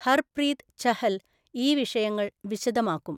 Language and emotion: Malayalam, neutral